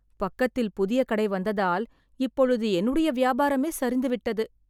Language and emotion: Tamil, sad